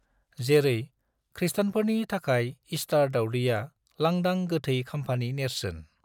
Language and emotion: Bodo, neutral